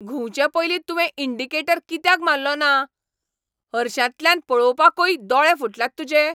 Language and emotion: Goan Konkani, angry